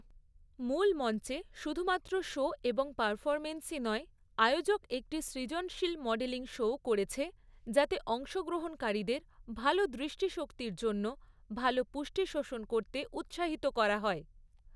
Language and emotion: Bengali, neutral